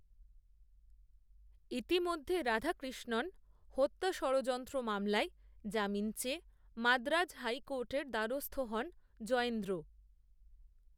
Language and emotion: Bengali, neutral